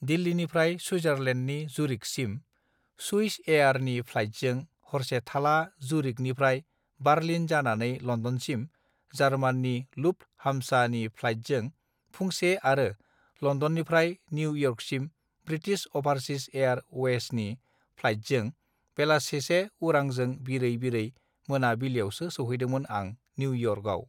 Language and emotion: Bodo, neutral